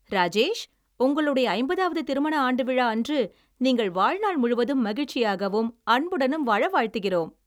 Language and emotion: Tamil, happy